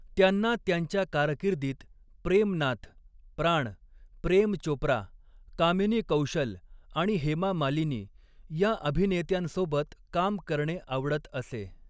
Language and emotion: Marathi, neutral